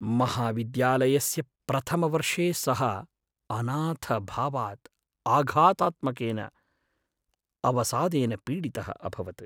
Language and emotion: Sanskrit, sad